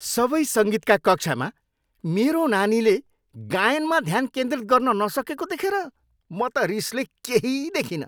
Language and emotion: Nepali, angry